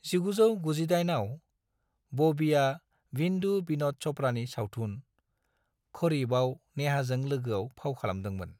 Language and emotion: Bodo, neutral